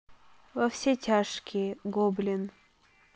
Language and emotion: Russian, neutral